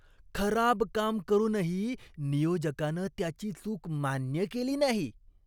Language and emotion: Marathi, disgusted